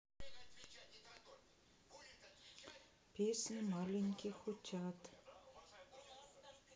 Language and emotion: Russian, sad